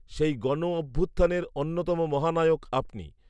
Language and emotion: Bengali, neutral